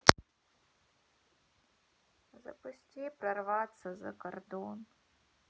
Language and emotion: Russian, sad